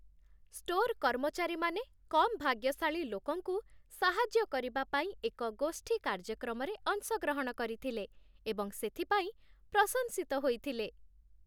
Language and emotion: Odia, happy